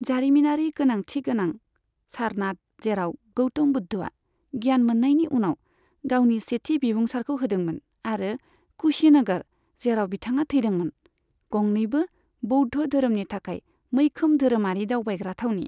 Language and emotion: Bodo, neutral